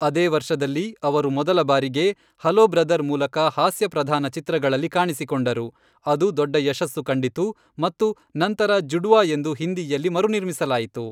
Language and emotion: Kannada, neutral